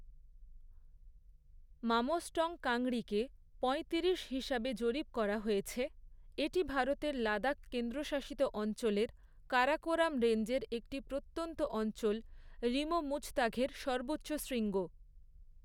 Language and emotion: Bengali, neutral